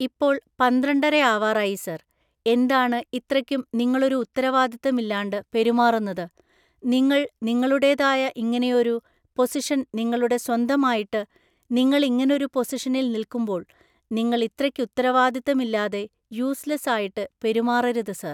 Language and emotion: Malayalam, neutral